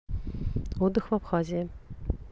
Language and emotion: Russian, neutral